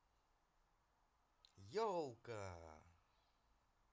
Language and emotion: Russian, positive